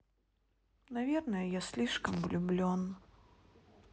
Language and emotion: Russian, sad